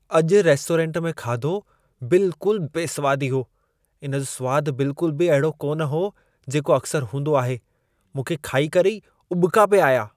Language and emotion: Sindhi, disgusted